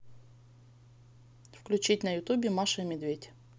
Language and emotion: Russian, neutral